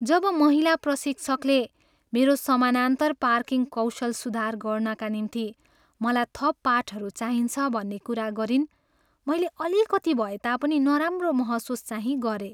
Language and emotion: Nepali, sad